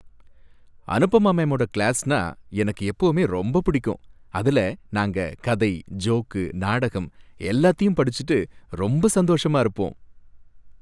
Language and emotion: Tamil, happy